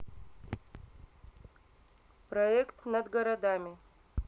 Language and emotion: Russian, neutral